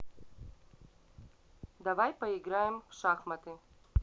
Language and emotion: Russian, neutral